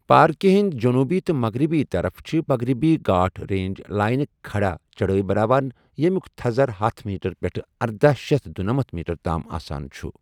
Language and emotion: Kashmiri, neutral